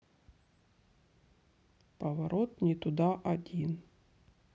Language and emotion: Russian, neutral